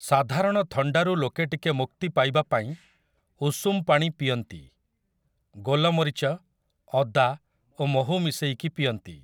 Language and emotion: Odia, neutral